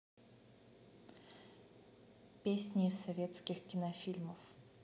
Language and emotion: Russian, neutral